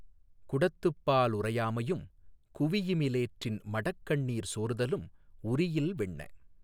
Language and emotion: Tamil, neutral